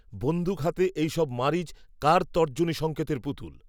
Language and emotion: Bengali, neutral